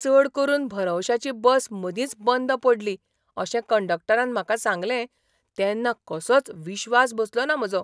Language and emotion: Goan Konkani, surprised